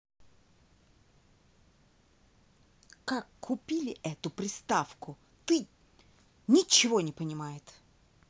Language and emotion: Russian, angry